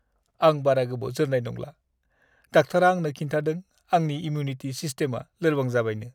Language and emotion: Bodo, sad